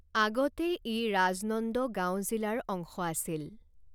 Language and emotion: Assamese, neutral